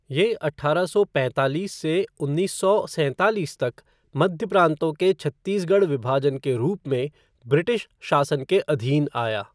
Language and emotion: Hindi, neutral